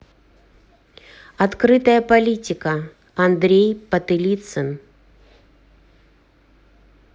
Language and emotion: Russian, neutral